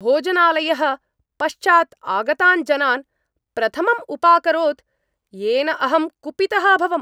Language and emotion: Sanskrit, angry